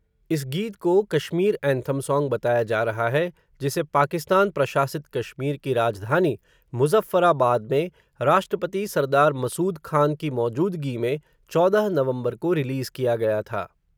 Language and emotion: Hindi, neutral